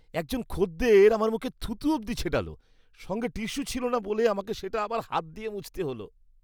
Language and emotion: Bengali, disgusted